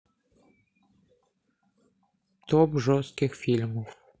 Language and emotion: Russian, neutral